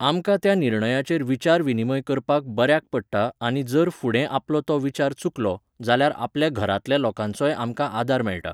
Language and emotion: Goan Konkani, neutral